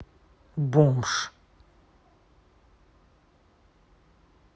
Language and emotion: Russian, angry